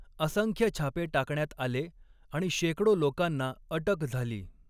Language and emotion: Marathi, neutral